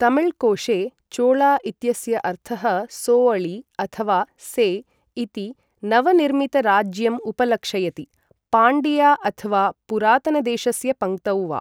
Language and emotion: Sanskrit, neutral